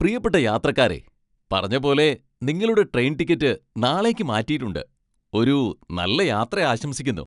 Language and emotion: Malayalam, happy